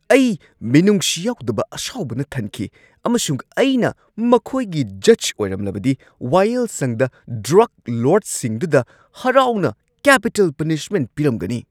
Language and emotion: Manipuri, angry